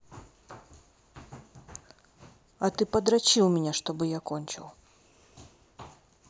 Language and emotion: Russian, neutral